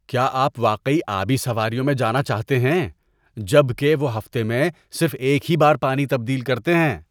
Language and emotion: Urdu, disgusted